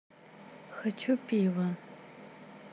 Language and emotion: Russian, neutral